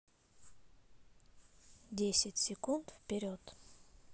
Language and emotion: Russian, neutral